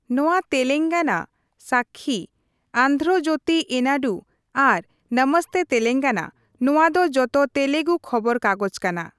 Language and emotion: Santali, neutral